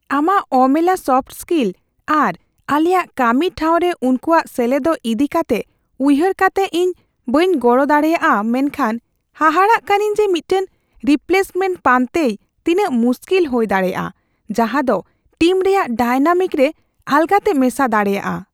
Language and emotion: Santali, fearful